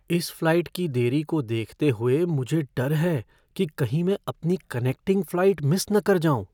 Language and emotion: Hindi, fearful